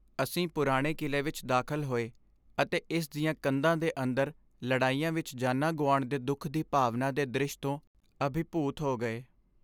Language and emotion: Punjabi, sad